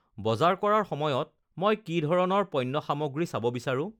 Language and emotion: Assamese, neutral